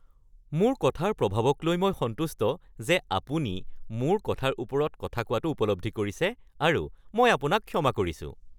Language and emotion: Assamese, happy